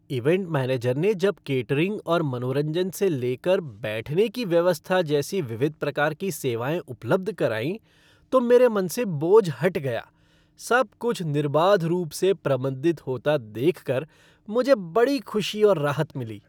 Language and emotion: Hindi, happy